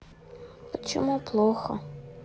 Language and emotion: Russian, sad